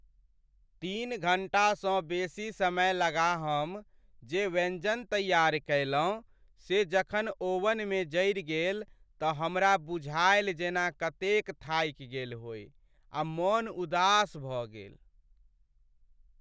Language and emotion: Maithili, sad